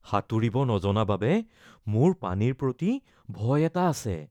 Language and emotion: Assamese, fearful